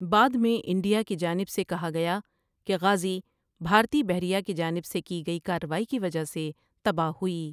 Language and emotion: Urdu, neutral